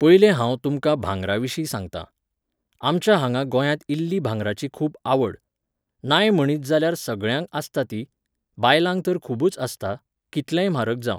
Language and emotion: Goan Konkani, neutral